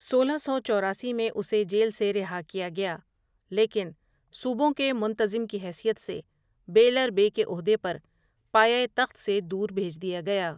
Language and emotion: Urdu, neutral